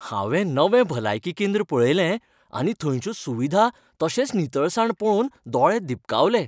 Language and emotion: Goan Konkani, happy